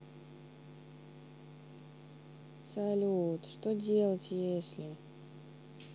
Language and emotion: Russian, sad